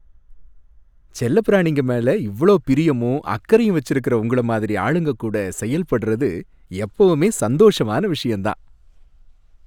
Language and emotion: Tamil, happy